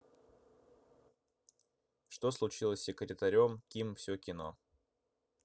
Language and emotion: Russian, neutral